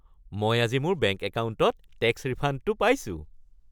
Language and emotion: Assamese, happy